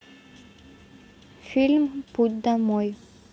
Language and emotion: Russian, neutral